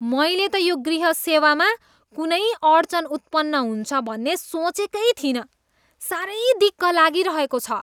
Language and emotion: Nepali, disgusted